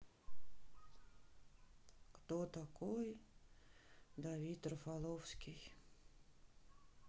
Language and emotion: Russian, sad